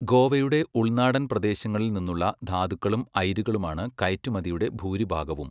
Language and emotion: Malayalam, neutral